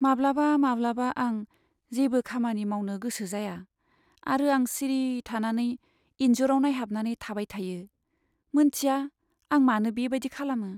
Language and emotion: Bodo, sad